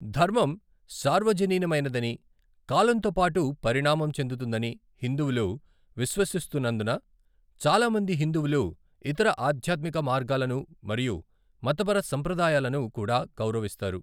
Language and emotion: Telugu, neutral